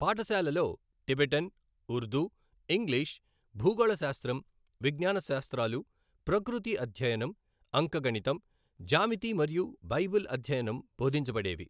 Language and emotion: Telugu, neutral